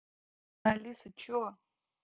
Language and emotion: Russian, neutral